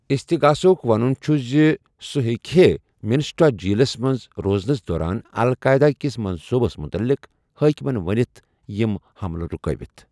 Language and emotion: Kashmiri, neutral